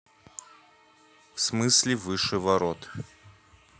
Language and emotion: Russian, neutral